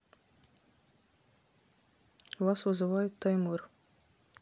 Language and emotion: Russian, neutral